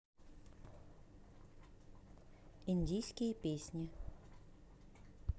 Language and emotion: Russian, neutral